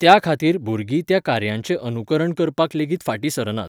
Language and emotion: Goan Konkani, neutral